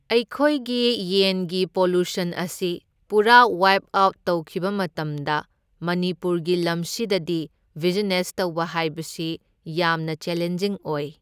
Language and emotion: Manipuri, neutral